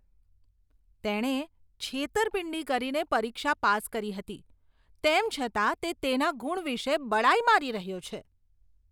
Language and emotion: Gujarati, disgusted